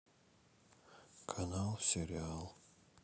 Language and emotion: Russian, sad